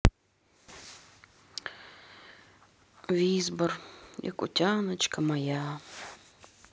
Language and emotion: Russian, sad